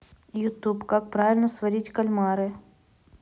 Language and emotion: Russian, neutral